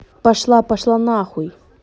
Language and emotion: Russian, angry